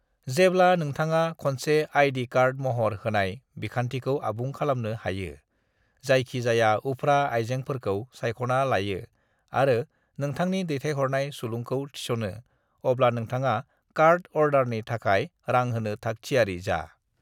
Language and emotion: Bodo, neutral